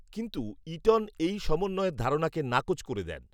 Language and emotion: Bengali, neutral